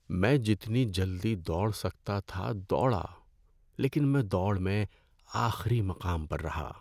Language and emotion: Urdu, sad